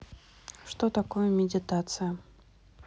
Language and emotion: Russian, neutral